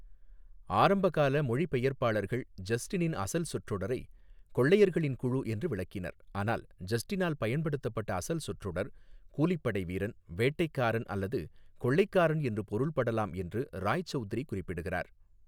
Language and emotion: Tamil, neutral